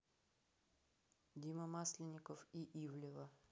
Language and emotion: Russian, neutral